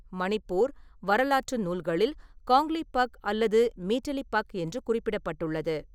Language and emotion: Tamil, neutral